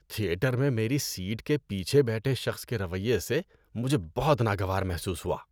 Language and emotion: Urdu, disgusted